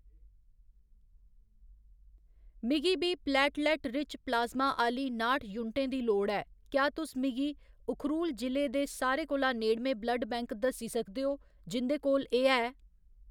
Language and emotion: Dogri, neutral